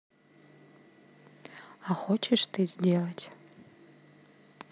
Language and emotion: Russian, neutral